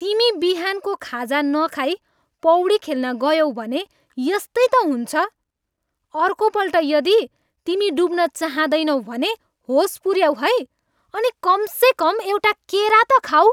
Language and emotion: Nepali, angry